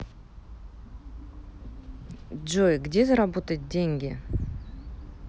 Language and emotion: Russian, neutral